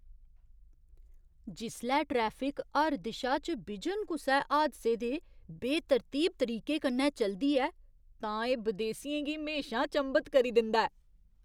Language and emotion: Dogri, surprised